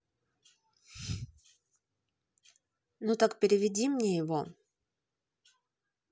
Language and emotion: Russian, neutral